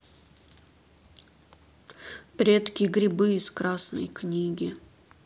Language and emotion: Russian, sad